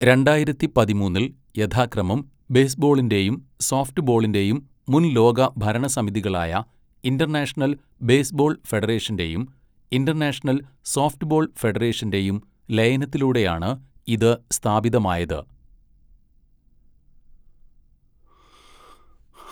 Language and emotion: Malayalam, neutral